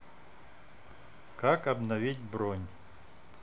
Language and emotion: Russian, neutral